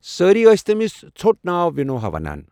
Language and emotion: Kashmiri, neutral